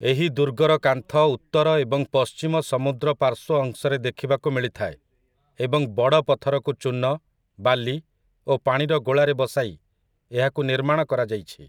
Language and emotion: Odia, neutral